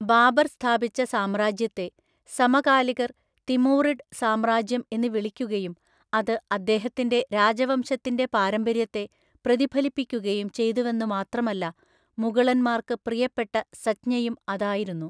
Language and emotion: Malayalam, neutral